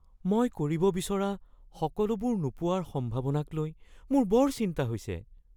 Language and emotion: Assamese, fearful